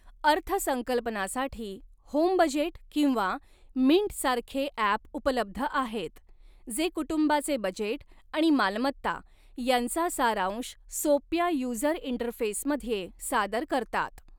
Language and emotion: Marathi, neutral